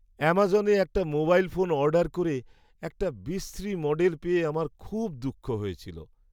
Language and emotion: Bengali, sad